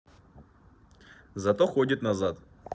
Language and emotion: Russian, neutral